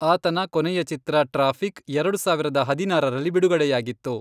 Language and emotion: Kannada, neutral